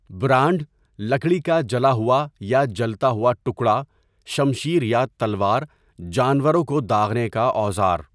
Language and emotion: Urdu, neutral